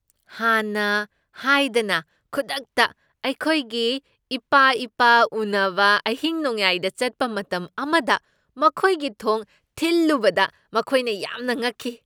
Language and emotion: Manipuri, surprised